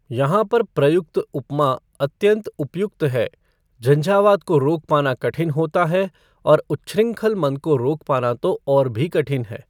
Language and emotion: Hindi, neutral